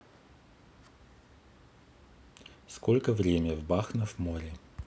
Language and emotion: Russian, neutral